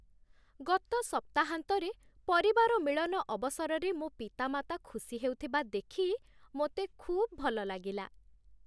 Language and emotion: Odia, happy